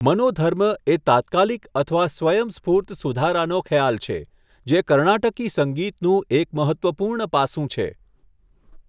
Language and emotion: Gujarati, neutral